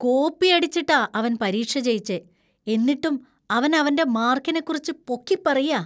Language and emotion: Malayalam, disgusted